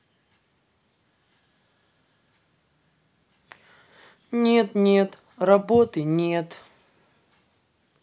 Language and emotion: Russian, sad